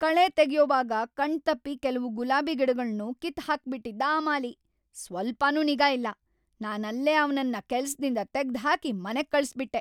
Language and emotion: Kannada, angry